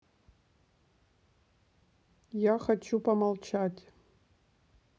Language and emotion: Russian, neutral